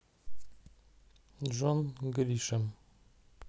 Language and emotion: Russian, neutral